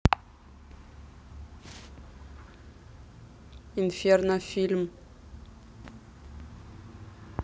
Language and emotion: Russian, neutral